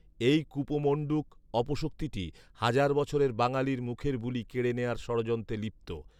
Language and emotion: Bengali, neutral